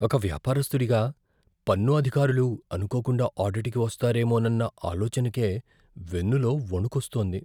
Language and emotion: Telugu, fearful